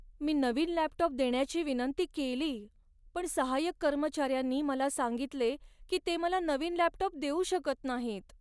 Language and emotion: Marathi, sad